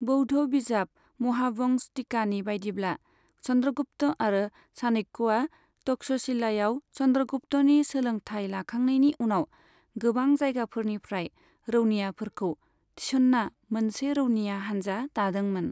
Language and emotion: Bodo, neutral